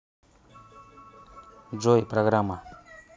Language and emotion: Russian, neutral